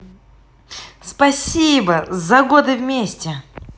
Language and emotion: Russian, positive